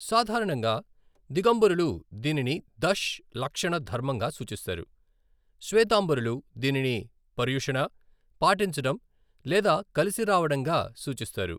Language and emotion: Telugu, neutral